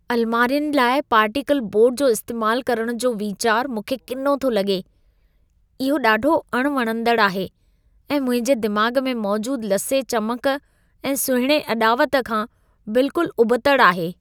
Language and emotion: Sindhi, disgusted